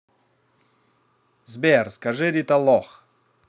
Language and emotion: Russian, positive